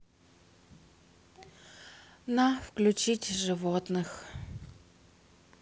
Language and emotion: Russian, sad